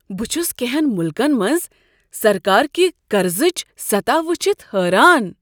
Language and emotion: Kashmiri, surprised